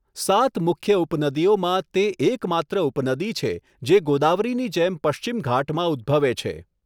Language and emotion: Gujarati, neutral